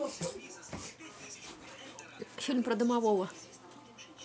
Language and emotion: Russian, neutral